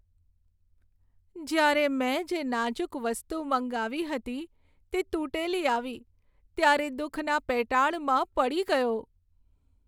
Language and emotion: Gujarati, sad